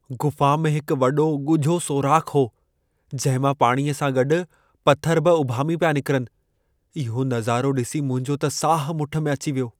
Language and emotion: Sindhi, fearful